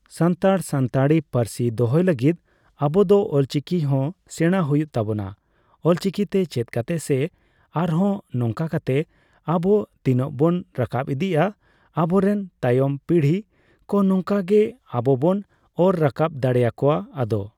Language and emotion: Santali, neutral